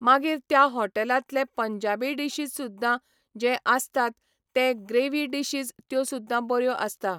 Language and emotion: Goan Konkani, neutral